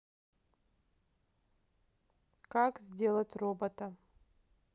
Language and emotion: Russian, neutral